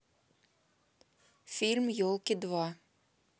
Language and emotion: Russian, neutral